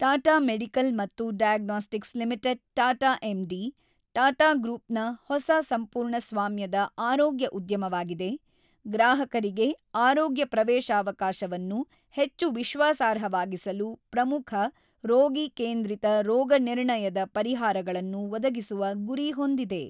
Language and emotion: Kannada, neutral